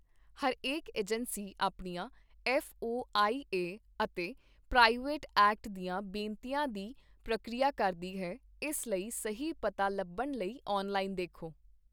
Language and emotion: Punjabi, neutral